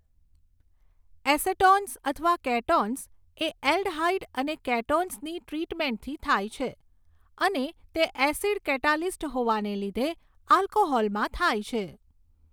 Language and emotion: Gujarati, neutral